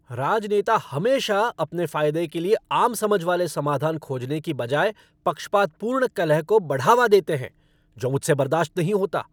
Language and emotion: Hindi, angry